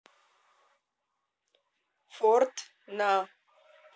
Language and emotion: Russian, neutral